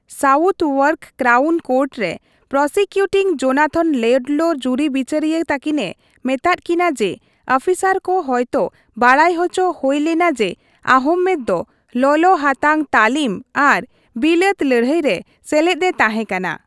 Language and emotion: Santali, neutral